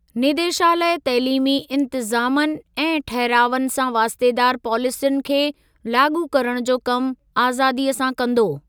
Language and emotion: Sindhi, neutral